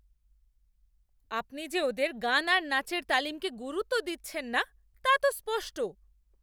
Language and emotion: Bengali, angry